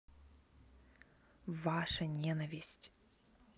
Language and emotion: Russian, neutral